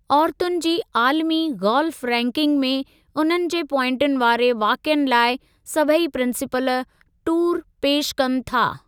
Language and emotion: Sindhi, neutral